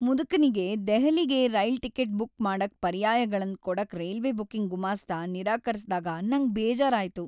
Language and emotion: Kannada, sad